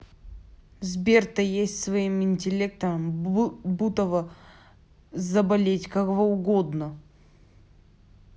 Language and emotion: Russian, angry